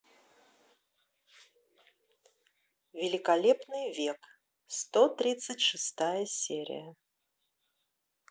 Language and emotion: Russian, neutral